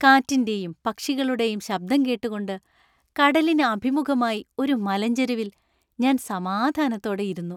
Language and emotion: Malayalam, happy